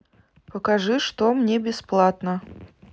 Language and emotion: Russian, neutral